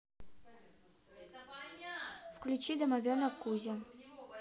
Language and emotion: Russian, neutral